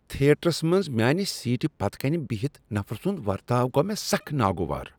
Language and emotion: Kashmiri, disgusted